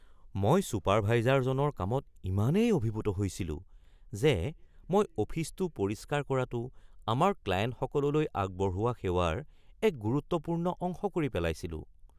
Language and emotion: Assamese, surprised